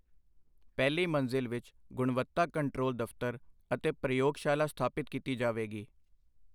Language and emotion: Punjabi, neutral